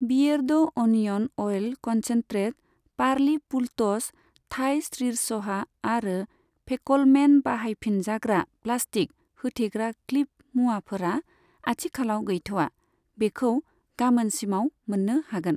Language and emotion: Bodo, neutral